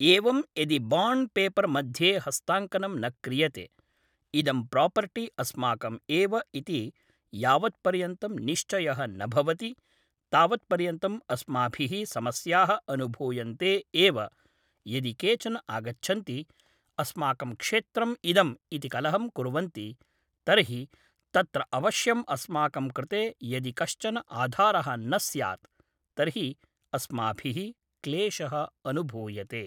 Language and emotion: Sanskrit, neutral